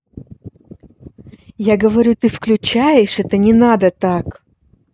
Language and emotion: Russian, angry